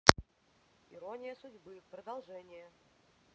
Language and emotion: Russian, neutral